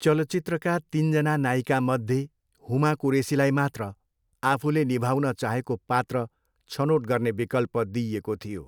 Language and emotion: Nepali, neutral